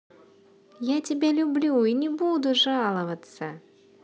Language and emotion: Russian, positive